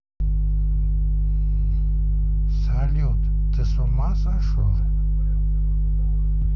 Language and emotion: Russian, neutral